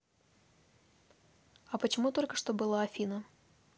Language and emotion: Russian, neutral